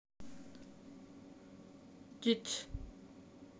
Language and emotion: Russian, neutral